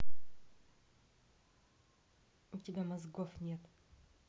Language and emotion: Russian, neutral